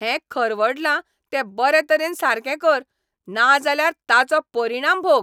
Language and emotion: Goan Konkani, angry